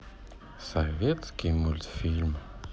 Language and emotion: Russian, sad